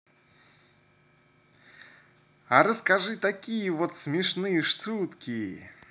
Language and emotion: Russian, positive